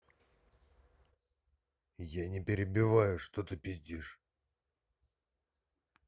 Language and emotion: Russian, angry